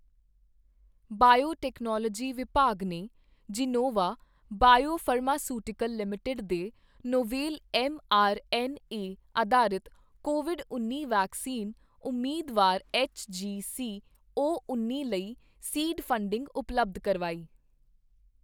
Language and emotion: Punjabi, neutral